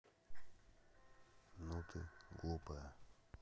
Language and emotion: Russian, neutral